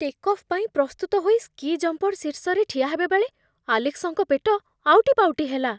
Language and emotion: Odia, fearful